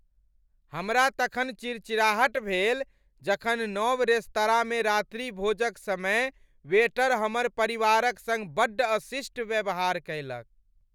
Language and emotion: Maithili, angry